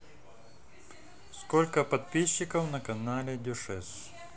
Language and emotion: Russian, neutral